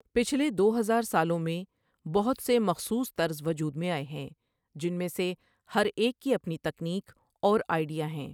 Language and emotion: Urdu, neutral